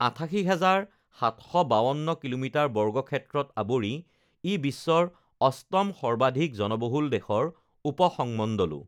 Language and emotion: Assamese, neutral